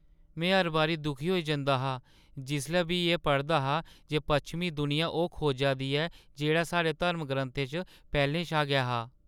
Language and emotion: Dogri, sad